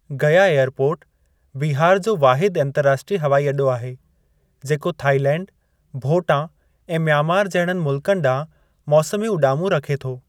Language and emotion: Sindhi, neutral